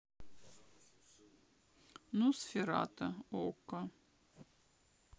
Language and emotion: Russian, sad